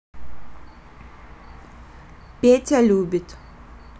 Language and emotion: Russian, neutral